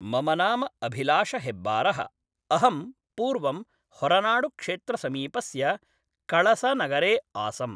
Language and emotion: Sanskrit, neutral